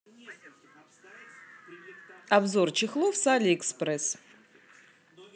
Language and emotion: Russian, positive